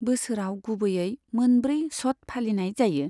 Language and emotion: Bodo, neutral